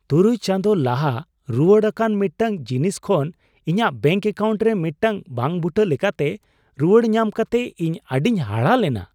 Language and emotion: Santali, surprised